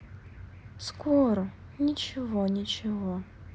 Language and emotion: Russian, sad